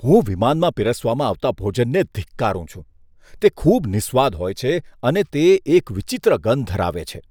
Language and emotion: Gujarati, disgusted